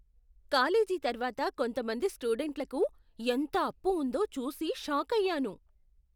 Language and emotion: Telugu, surprised